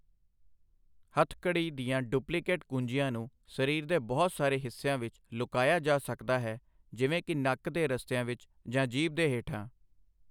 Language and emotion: Punjabi, neutral